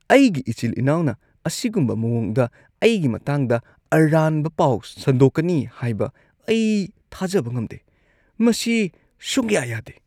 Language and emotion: Manipuri, disgusted